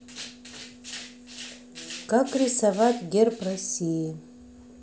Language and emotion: Russian, neutral